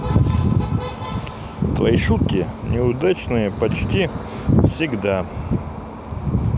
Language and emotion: Russian, neutral